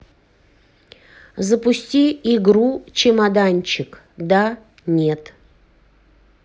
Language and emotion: Russian, neutral